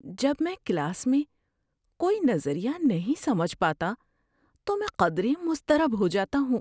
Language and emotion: Urdu, fearful